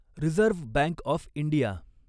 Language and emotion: Marathi, neutral